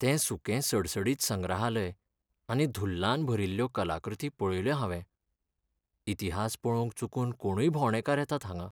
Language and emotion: Goan Konkani, sad